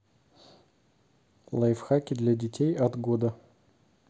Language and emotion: Russian, neutral